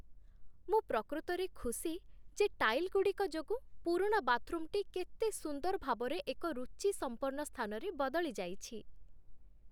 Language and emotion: Odia, happy